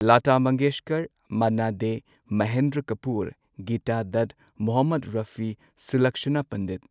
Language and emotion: Manipuri, neutral